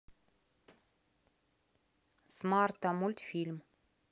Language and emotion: Russian, neutral